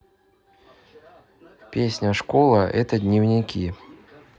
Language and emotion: Russian, neutral